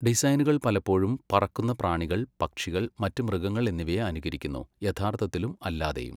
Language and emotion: Malayalam, neutral